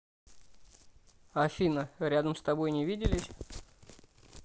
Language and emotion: Russian, neutral